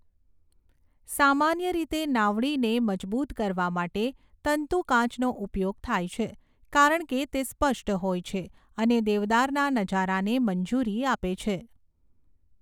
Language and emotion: Gujarati, neutral